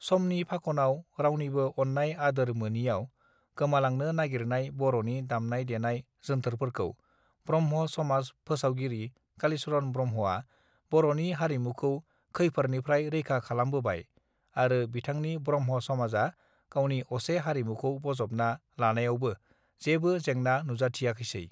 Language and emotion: Bodo, neutral